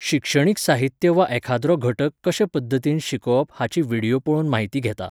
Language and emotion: Goan Konkani, neutral